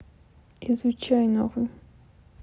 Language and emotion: Russian, sad